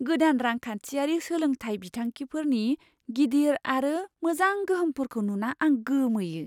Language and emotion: Bodo, surprised